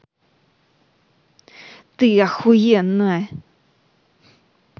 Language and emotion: Russian, angry